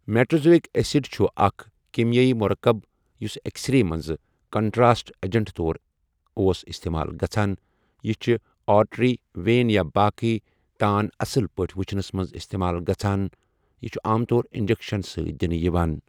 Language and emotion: Kashmiri, neutral